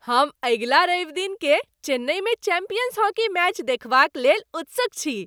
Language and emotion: Maithili, happy